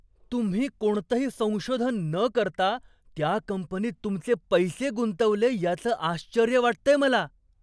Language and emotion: Marathi, surprised